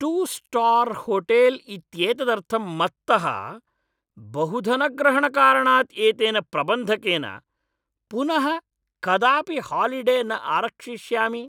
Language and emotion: Sanskrit, angry